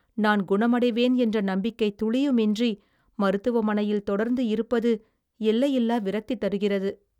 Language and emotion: Tamil, sad